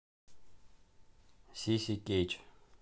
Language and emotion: Russian, neutral